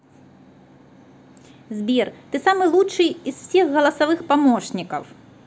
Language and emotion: Russian, positive